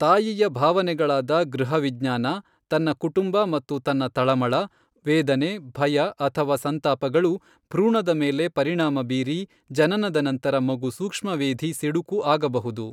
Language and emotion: Kannada, neutral